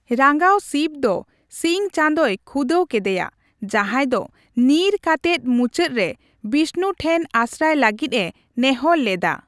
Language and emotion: Santali, neutral